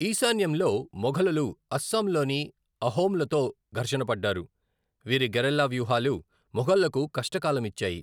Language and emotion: Telugu, neutral